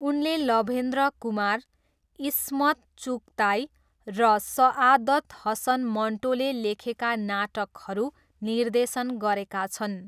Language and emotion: Nepali, neutral